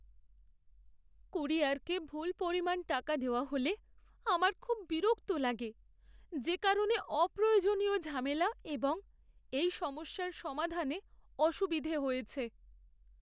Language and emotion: Bengali, sad